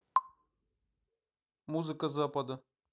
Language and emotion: Russian, neutral